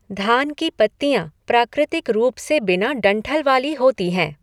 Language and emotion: Hindi, neutral